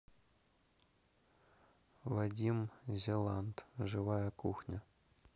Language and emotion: Russian, neutral